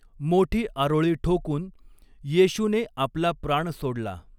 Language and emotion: Marathi, neutral